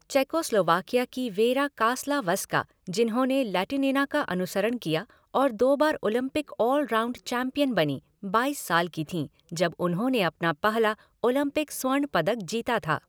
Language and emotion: Hindi, neutral